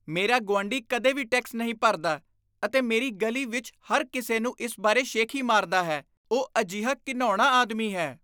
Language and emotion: Punjabi, disgusted